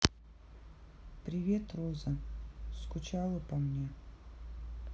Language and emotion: Russian, sad